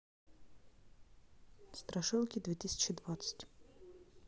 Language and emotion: Russian, neutral